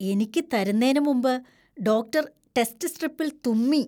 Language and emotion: Malayalam, disgusted